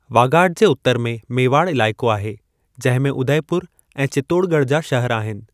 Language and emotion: Sindhi, neutral